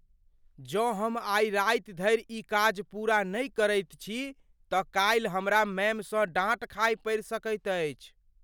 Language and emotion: Maithili, fearful